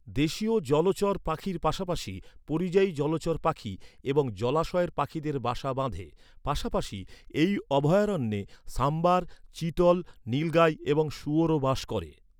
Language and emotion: Bengali, neutral